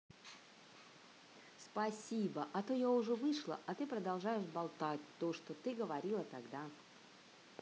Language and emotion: Russian, positive